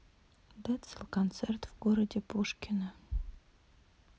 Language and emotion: Russian, neutral